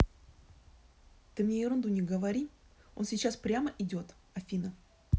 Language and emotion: Russian, angry